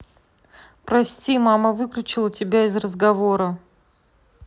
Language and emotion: Russian, neutral